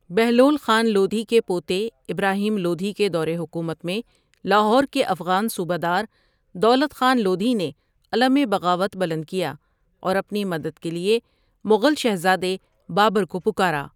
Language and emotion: Urdu, neutral